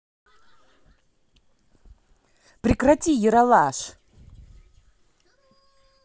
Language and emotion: Russian, angry